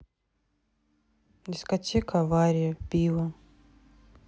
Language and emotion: Russian, neutral